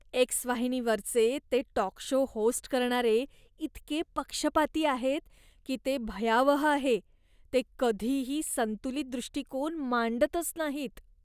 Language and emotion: Marathi, disgusted